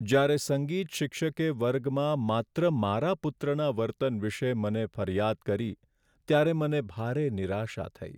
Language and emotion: Gujarati, sad